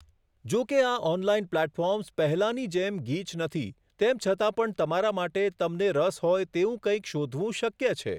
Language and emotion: Gujarati, neutral